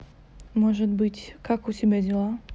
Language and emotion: Russian, neutral